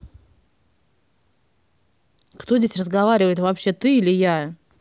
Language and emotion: Russian, angry